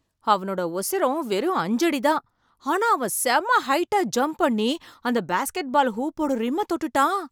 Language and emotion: Tamil, surprised